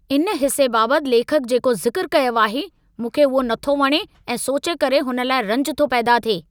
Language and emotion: Sindhi, angry